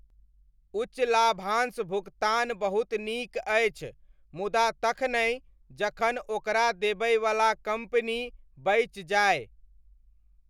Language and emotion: Maithili, neutral